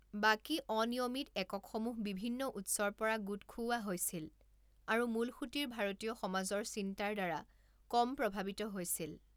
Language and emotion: Assamese, neutral